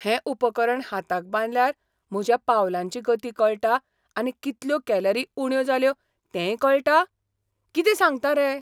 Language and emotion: Goan Konkani, surprised